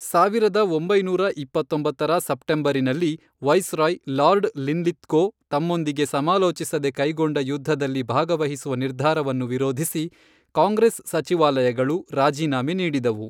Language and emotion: Kannada, neutral